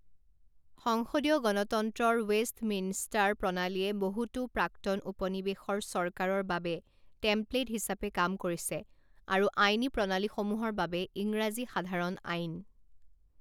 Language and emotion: Assamese, neutral